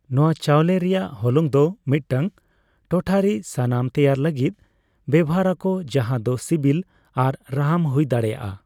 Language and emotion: Santali, neutral